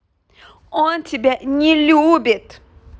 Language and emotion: Russian, angry